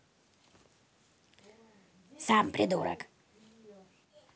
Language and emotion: Russian, angry